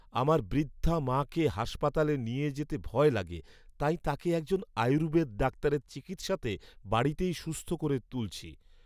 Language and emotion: Bengali, happy